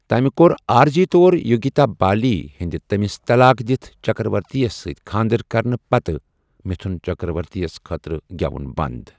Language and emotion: Kashmiri, neutral